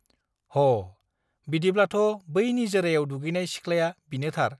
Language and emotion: Bodo, neutral